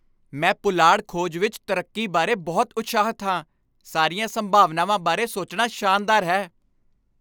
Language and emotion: Punjabi, happy